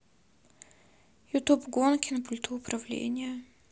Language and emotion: Russian, sad